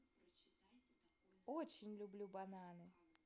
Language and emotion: Russian, positive